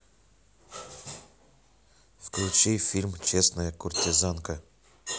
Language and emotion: Russian, neutral